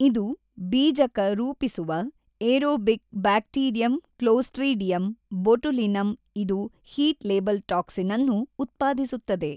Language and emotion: Kannada, neutral